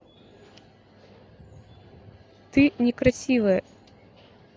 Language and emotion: Russian, neutral